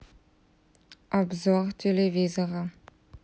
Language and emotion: Russian, neutral